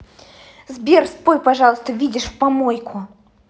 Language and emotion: Russian, angry